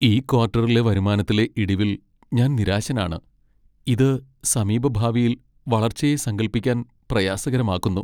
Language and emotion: Malayalam, sad